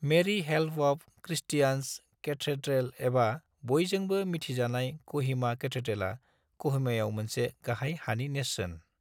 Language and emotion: Bodo, neutral